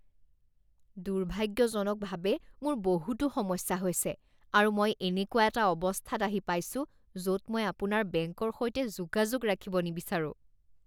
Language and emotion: Assamese, disgusted